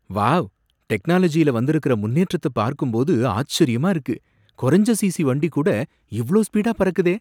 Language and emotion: Tamil, surprised